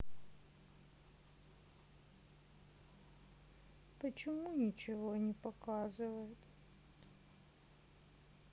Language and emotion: Russian, sad